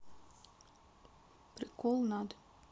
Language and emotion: Russian, neutral